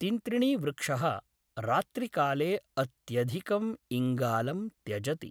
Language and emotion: Sanskrit, neutral